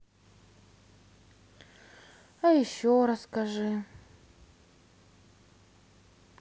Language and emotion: Russian, sad